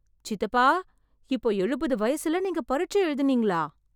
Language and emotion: Tamil, surprised